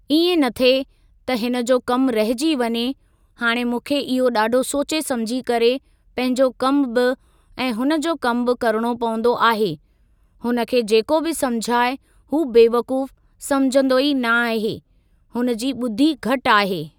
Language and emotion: Sindhi, neutral